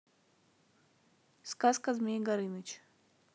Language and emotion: Russian, neutral